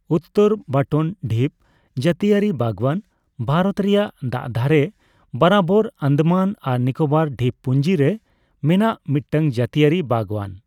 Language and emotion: Santali, neutral